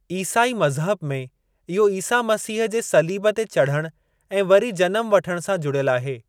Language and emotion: Sindhi, neutral